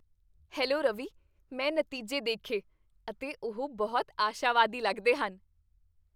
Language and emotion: Punjabi, happy